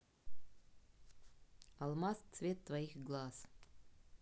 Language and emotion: Russian, neutral